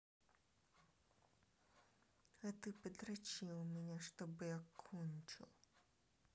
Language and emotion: Russian, angry